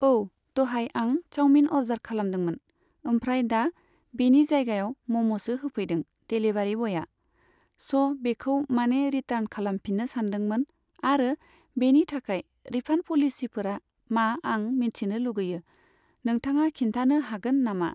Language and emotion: Bodo, neutral